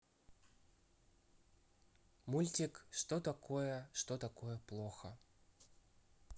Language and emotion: Russian, neutral